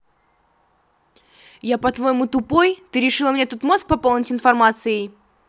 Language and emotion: Russian, angry